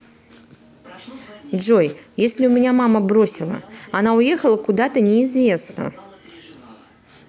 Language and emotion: Russian, neutral